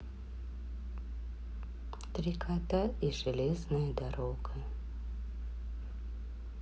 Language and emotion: Russian, sad